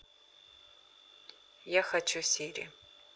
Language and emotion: Russian, neutral